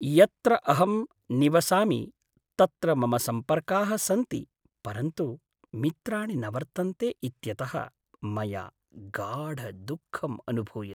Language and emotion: Sanskrit, sad